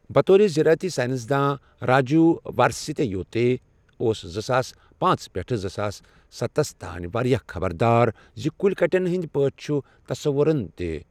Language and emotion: Kashmiri, neutral